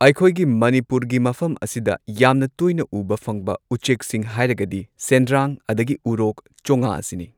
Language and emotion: Manipuri, neutral